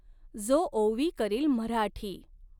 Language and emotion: Marathi, neutral